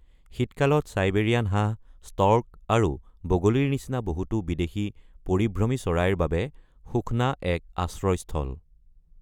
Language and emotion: Assamese, neutral